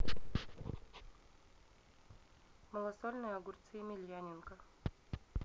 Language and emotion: Russian, neutral